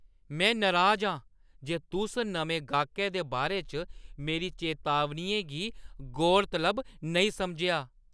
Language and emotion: Dogri, angry